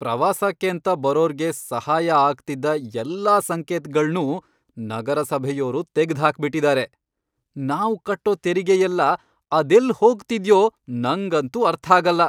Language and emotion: Kannada, angry